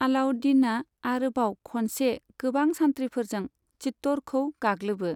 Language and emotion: Bodo, neutral